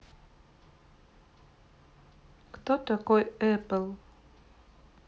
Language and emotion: Russian, neutral